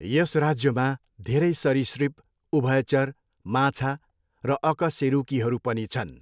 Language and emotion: Nepali, neutral